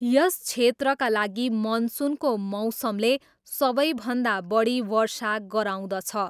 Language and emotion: Nepali, neutral